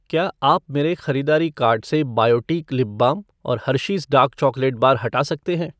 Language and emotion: Hindi, neutral